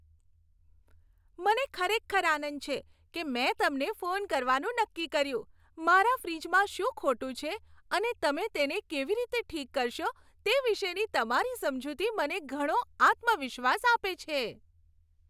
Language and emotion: Gujarati, happy